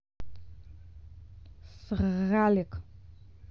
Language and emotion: Russian, neutral